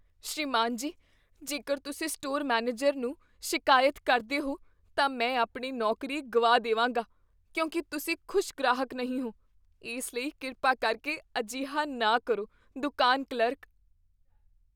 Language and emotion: Punjabi, fearful